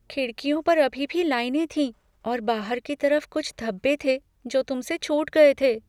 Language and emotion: Hindi, fearful